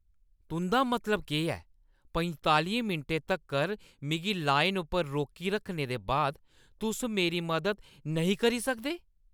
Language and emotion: Dogri, angry